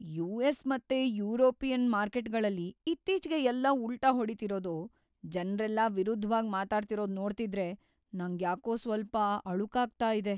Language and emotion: Kannada, fearful